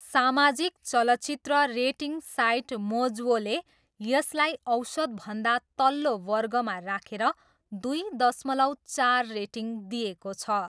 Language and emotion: Nepali, neutral